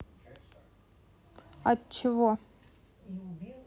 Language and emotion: Russian, neutral